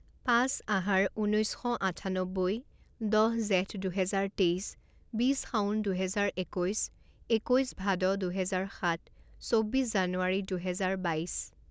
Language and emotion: Assamese, neutral